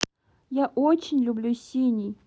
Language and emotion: Russian, neutral